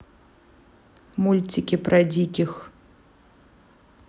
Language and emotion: Russian, neutral